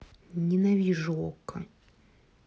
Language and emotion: Russian, angry